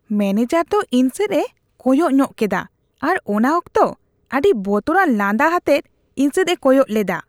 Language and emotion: Santali, disgusted